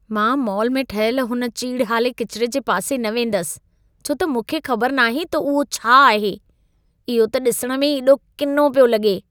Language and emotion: Sindhi, disgusted